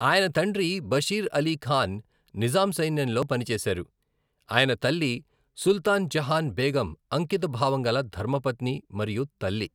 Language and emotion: Telugu, neutral